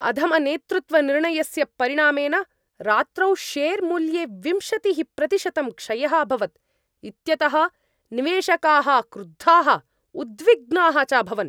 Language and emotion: Sanskrit, angry